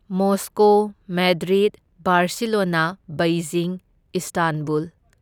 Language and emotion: Manipuri, neutral